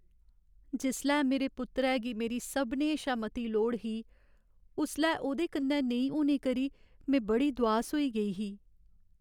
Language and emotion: Dogri, sad